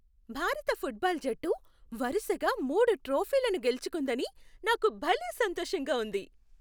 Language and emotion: Telugu, happy